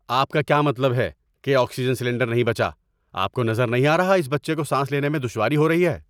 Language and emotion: Urdu, angry